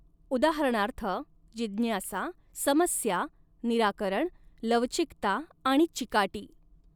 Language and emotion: Marathi, neutral